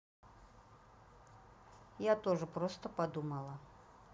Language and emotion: Russian, neutral